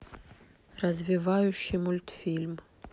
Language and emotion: Russian, neutral